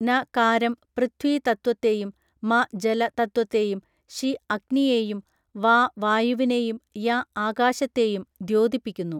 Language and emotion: Malayalam, neutral